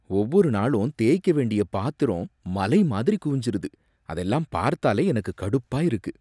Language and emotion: Tamil, disgusted